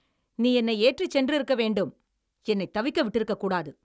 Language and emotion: Tamil, angry